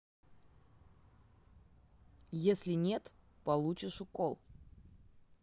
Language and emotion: Russian, neutral